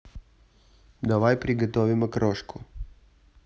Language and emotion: Russian, neutral